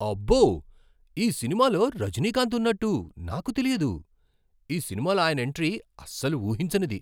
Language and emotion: Telugu, surprised